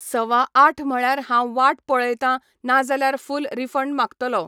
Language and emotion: Goan Konkani, neutral